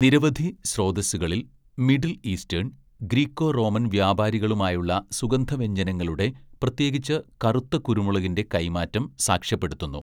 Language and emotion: Malayalam, neutral